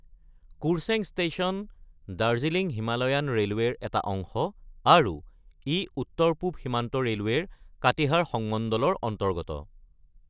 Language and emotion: Assamese, neutral